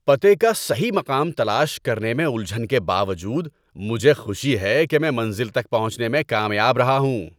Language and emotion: Urdu, happy